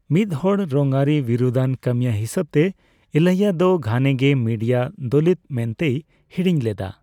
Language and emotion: Santali, neutral